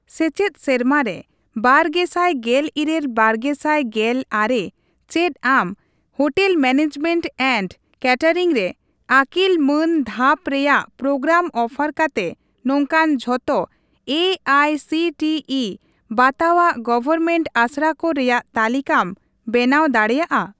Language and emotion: Santali, neutral